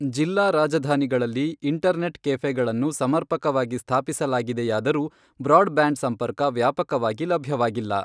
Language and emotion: Kannada, neutral